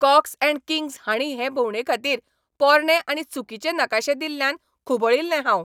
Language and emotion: Goan Konkani, angry